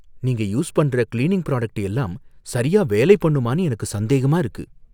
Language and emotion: Tamil, fearful